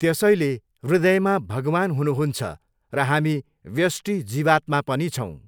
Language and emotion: Nepali, neutral